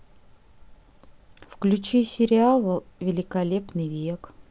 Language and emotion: Russian, neutral